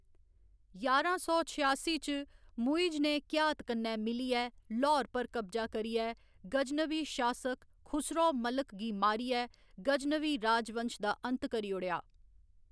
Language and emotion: Dogri, neutral